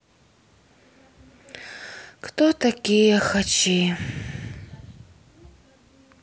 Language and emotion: Russian, sad